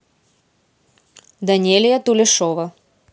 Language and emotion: Russian, neutral